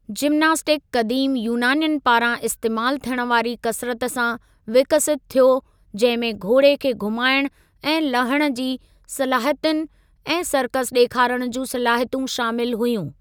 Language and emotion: Sindhi, neutral